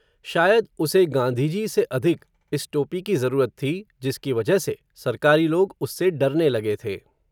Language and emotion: Hindi, neutral